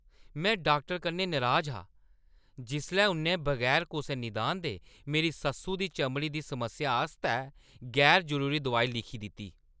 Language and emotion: Dogri, angry